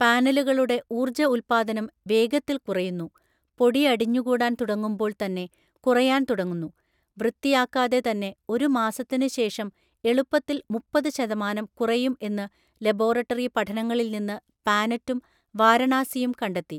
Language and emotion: Malayalam, neutral